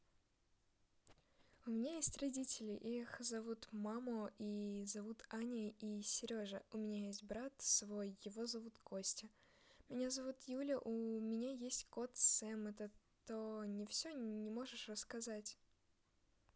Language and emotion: Russian, neutral